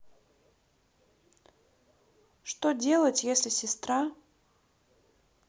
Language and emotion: Russian, neutral